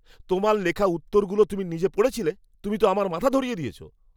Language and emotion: Bengali, angry